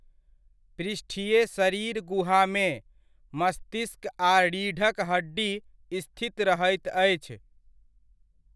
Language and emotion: Maithili, neutral